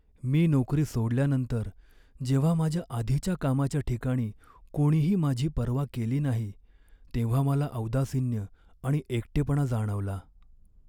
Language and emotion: Marathi, sad